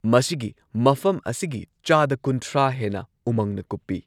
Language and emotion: Manipuri, neutral